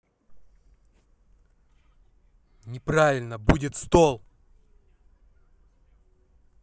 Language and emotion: Russian, angry